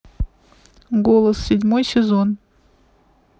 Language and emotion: Russian, neutral